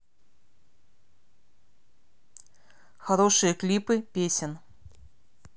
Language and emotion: Russian, neutral